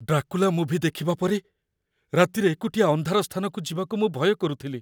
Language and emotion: Odia, fearful